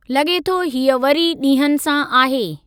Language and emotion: Sindhi, neutral